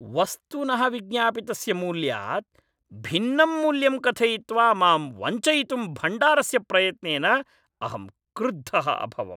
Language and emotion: Sanskrit, angry